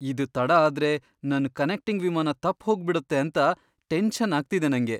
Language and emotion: Kannada, fearful